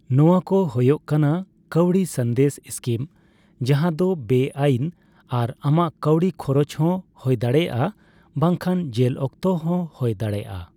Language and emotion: Santali, neutral